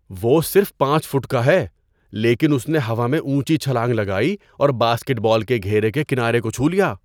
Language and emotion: Urdu, surprised